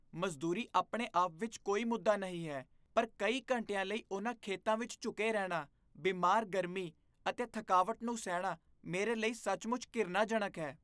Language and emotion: Punjabi, disgusted